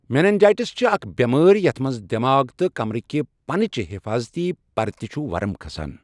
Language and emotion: Kashmiri, neutral